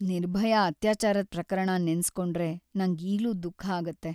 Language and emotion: Kannada, sad